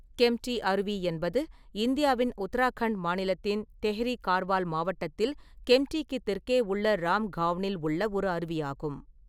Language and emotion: Tamil, neutral